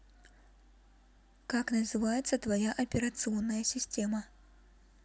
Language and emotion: Russian, neutral